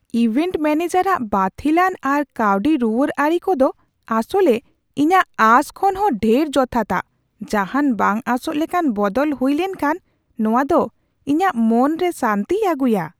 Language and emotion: Santali, surprised